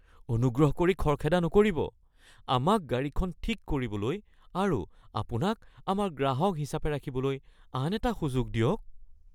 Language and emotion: Assamese, fearful